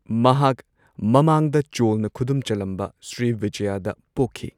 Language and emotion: Manipuri, neutral